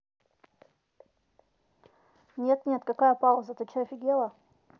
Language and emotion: Russian, neutral